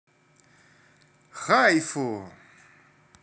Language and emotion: Russian, positive